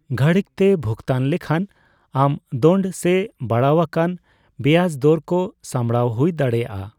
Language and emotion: Santali, neutral